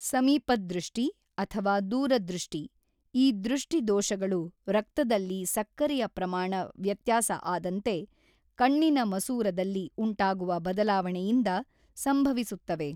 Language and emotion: Kannada, neutral